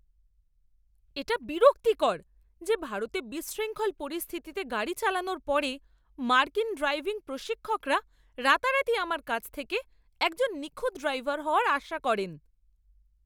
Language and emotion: Bengali, angry